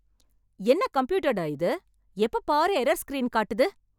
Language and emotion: Tamil, angry